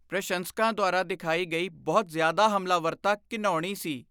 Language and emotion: Punjabi, disgusted